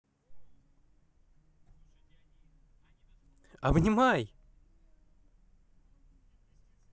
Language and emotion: Russian, positive